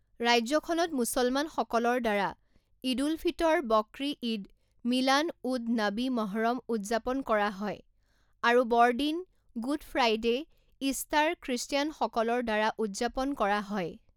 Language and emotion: Assamese, neutral